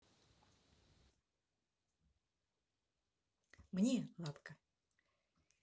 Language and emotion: Russian, positive